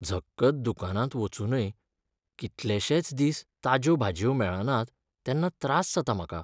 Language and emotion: Goan Konkani, sad